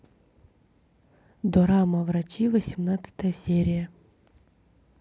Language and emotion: Russian, neutral